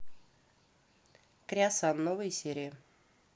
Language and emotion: Russian, neutral